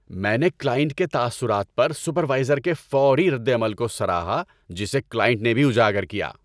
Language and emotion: Urdu, happy